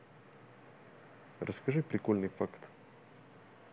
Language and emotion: Russian, neutral